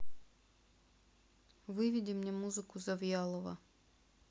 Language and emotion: Russian, neutral